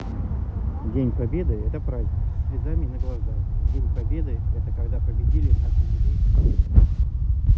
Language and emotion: Russian, neutral